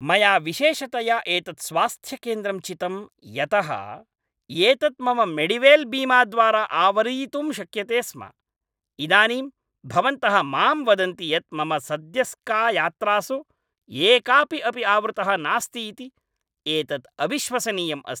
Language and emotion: Sanskrit, angry